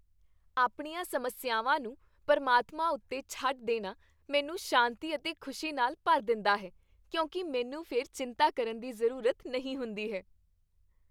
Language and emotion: Punjabi, happy